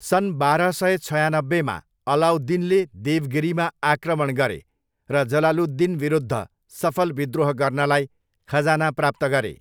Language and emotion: Nepali, neutral